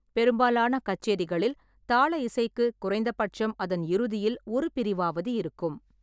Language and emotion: Tamil, neutral